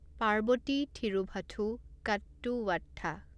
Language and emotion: Assamese, neutral